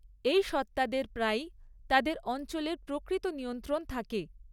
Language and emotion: Bengali, neutral